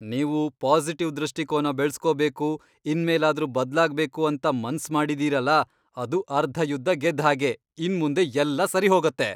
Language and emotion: Kannada, happy